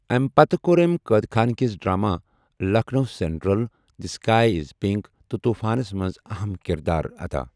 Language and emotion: Kashmiri, neutral